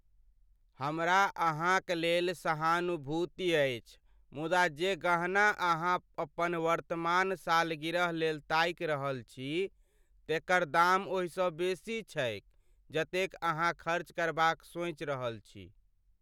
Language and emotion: Maithili, sad